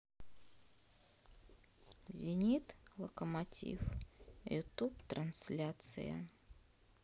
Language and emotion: Russian, sad